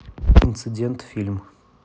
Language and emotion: Russian, neutral